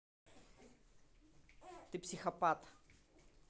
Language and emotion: Russian, angry